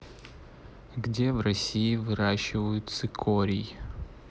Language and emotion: Russian, neutral